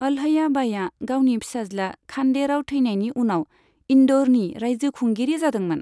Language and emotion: Bodo, neutral